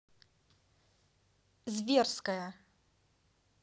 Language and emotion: Russian, neutral